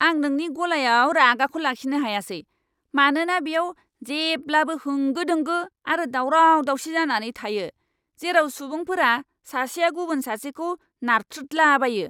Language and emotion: Bodo, angry